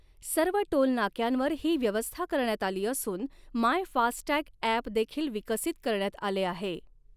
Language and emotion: Marathi, neutral